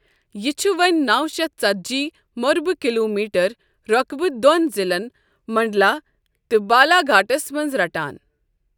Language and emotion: Kashmiri, neutral